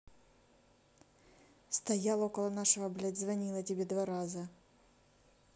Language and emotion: Russian, neutral